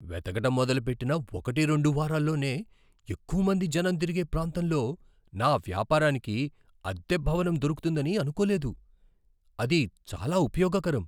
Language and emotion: Telugu, surprised